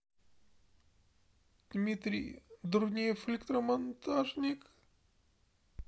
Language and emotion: Russian, sad